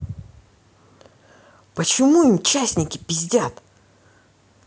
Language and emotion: Russian, angry